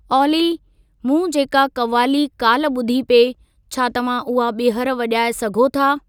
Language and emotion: Sindhi, neutral